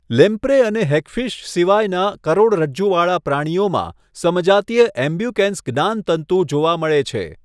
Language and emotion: Gujarati, neutral